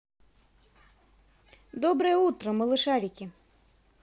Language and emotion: Russian, positive